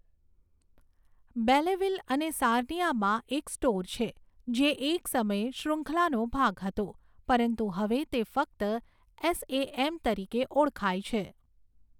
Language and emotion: Gujarati, neutral